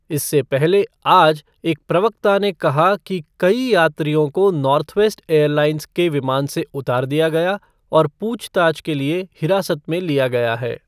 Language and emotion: Hindi, neutral